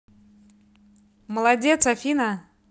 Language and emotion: Russian, positive